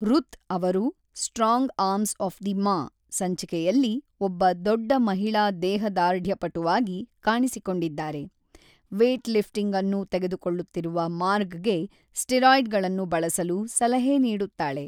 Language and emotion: Kannada, neutral